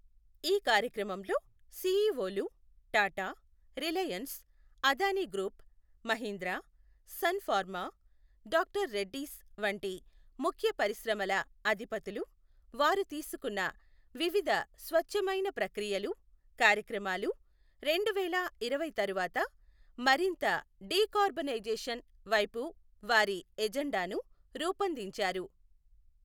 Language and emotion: Telugu, neutral